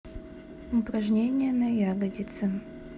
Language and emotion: Russian, neutral